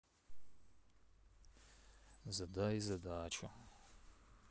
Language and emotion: Russian, sad